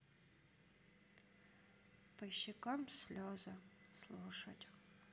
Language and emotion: Russian, sad